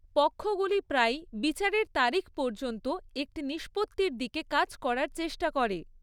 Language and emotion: Bengali, neutral